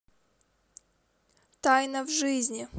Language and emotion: Russian, neutral